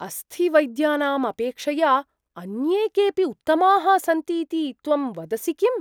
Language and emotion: Sanskrit, surprised